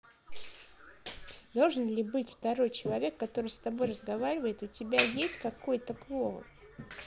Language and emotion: Russian, neutral